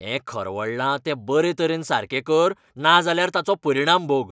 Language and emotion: Goan Konkani, angry